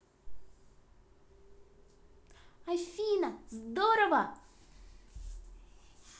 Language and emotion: Russian, positive